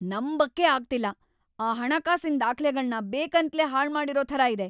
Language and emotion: Kannada, angry